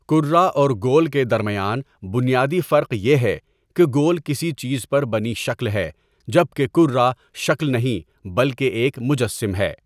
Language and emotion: Urdu, neutral